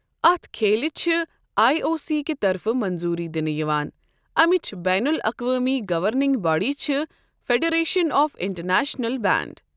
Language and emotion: Kashmiri, neutral